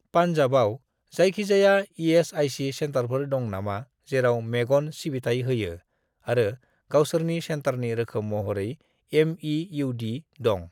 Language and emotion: Bodo, neutral